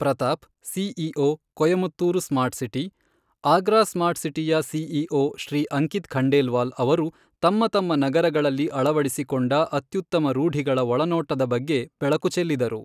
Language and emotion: Kannada, neutral